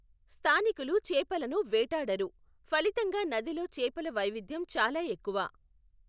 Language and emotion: Telugu, neutral